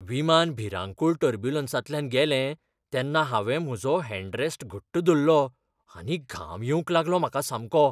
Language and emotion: Goan Konkani, fearful